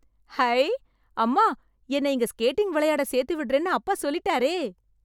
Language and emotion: Tamil, happy